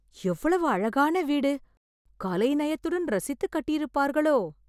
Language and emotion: Tamil, surprised